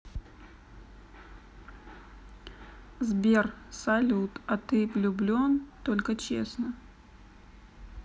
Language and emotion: Russian, neutral